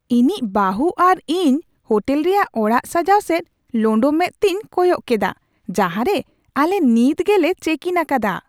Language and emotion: Santali, surprised